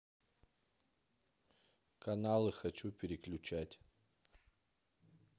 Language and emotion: Russian, neutral